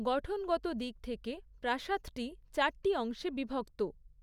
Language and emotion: Bengali, neutral